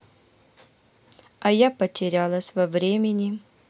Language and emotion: Russian, neutral